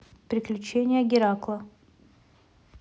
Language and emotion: Russian, neutral